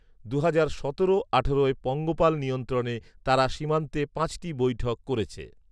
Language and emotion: Bengali, neutral